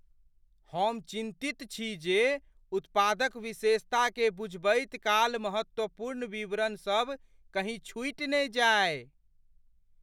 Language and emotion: Maithili, fearful